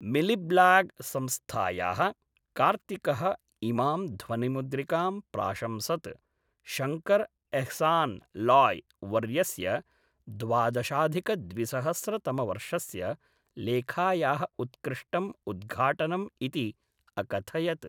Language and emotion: Sanskrit, neutral